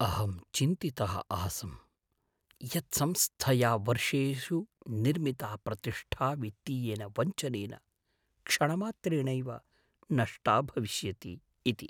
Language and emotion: Sanskrit, fearful